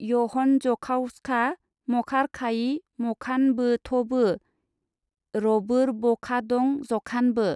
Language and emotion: Bodo, neutral